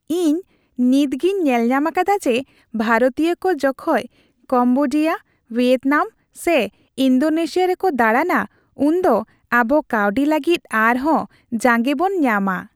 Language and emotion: Santali, happy